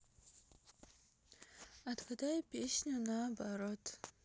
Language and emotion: Russian, sad